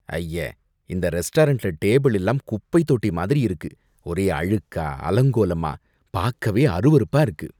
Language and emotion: Tamil, disgusted